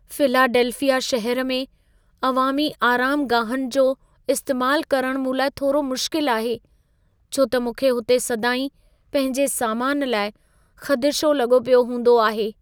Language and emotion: Sindhi, fearful